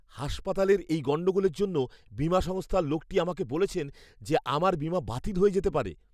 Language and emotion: Bengali, fearful